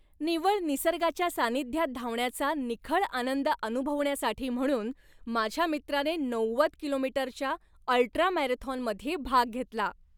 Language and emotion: Marathi, happy